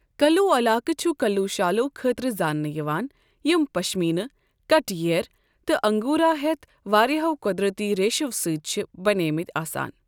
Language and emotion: Kashmiri, neutral